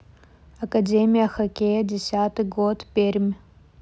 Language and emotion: Russian, neutral